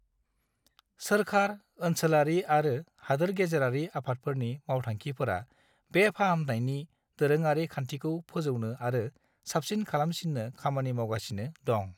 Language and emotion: Bodo, neutral